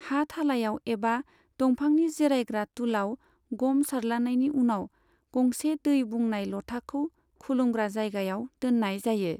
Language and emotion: Bodo, neutral